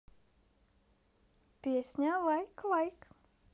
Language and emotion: Russian, positive